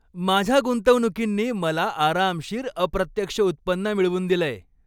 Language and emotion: Marathi, happy